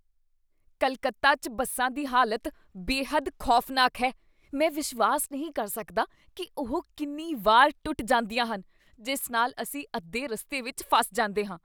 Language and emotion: Punjabi, disgusted